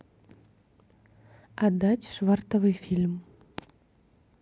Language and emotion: Russian, neutral